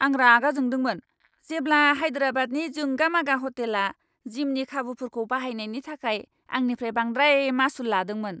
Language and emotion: Bodo, angry